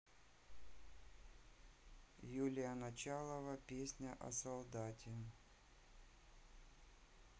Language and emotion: Russian, neutral